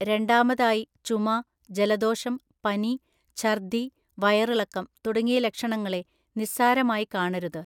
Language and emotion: Malayalam, neutral